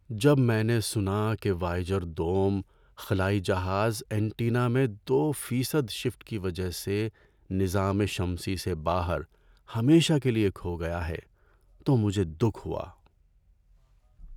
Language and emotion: Urdu, sad